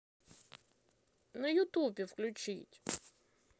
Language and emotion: Russian, positive